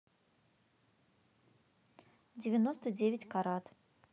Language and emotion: Russian, neutral